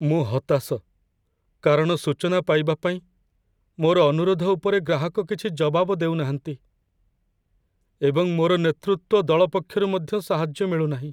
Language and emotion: Odia, sad